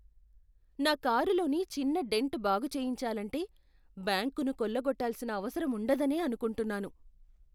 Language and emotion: Telugu, fearful